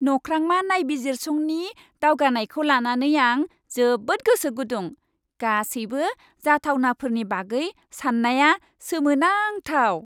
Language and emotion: Bodo, happy